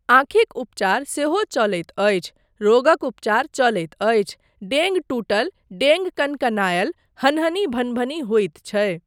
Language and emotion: Maithili, neutral